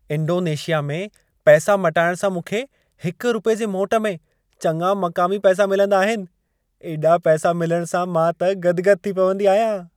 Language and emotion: Sindhi, happy